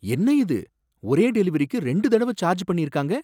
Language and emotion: Tamil, surprised